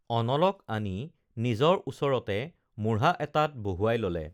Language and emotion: Assamese, neutral